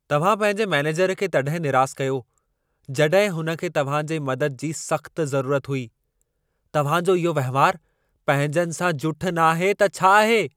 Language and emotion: Sindhi, angry